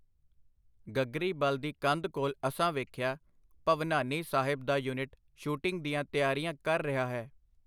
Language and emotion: Punjabi, neutral